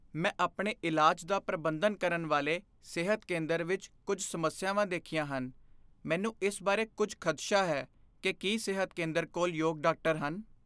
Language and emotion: Punjabi, fearful